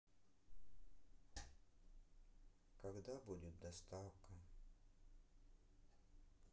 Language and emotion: Russian, sad